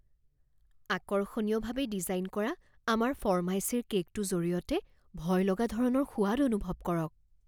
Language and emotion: Assamese, fearful